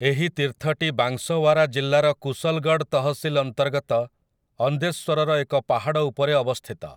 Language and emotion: Odia, neutral